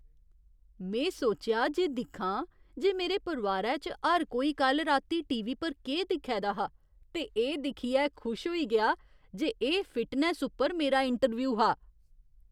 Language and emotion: Dogri, surprised